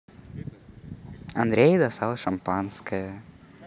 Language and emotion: Russian, positive